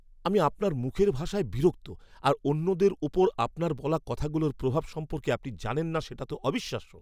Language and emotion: Bengali, angry